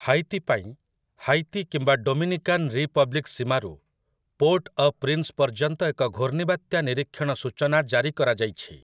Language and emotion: Odia, neutral